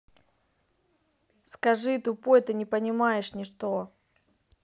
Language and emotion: Russian, neutral